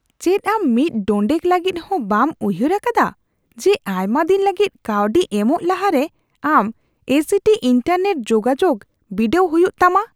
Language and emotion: Santali, disgusted